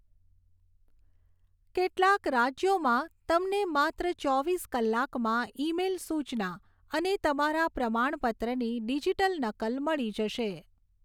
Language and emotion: Gujarati, neutral